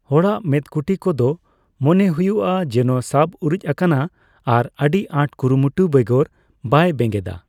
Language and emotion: Santali, neutral